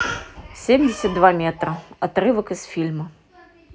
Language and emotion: Russian, neutral